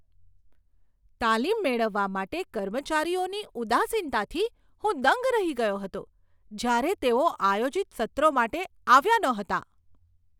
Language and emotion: Gujarati, surprised